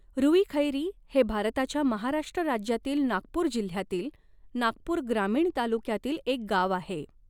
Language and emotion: Marathi, neutral